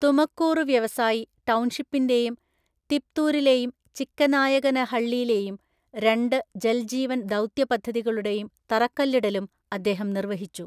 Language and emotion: Malayalam, neutral